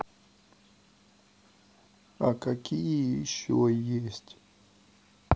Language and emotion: Russian, sad